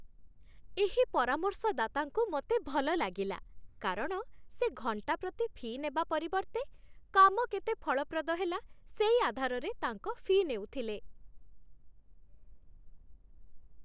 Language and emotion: Odia, happy